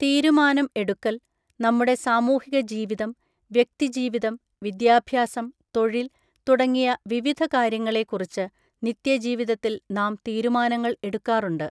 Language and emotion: Malayalam, neutral